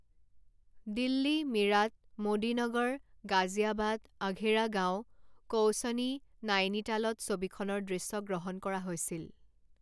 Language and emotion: Assamese, neutral